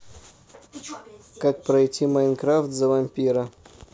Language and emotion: Russian, neutral